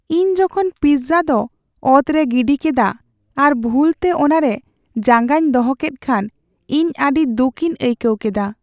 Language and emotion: Santali, sad